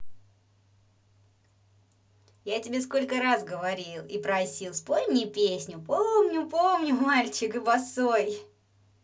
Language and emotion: Russian, positive